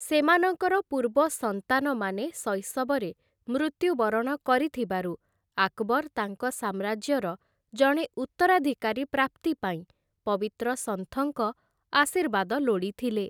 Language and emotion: Odia, neutral